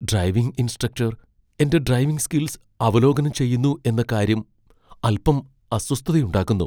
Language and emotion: Malayalam, fearful